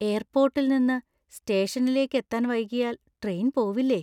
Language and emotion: Malayalam, fearful